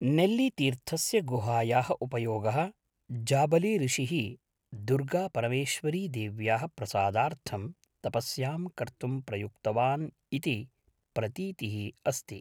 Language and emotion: Sanskrit, neutral